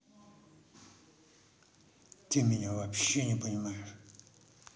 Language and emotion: Russian, angry